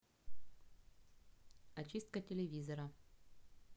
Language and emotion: Russian, neutral